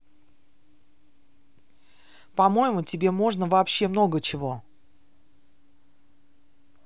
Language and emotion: Russian, angry